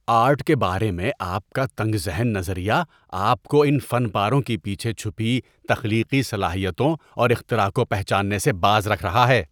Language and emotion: Urdu, disgusted